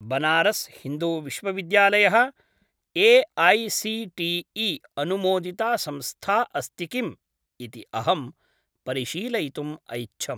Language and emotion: Sanskrit, neutral